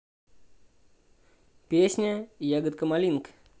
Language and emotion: Russian, neutral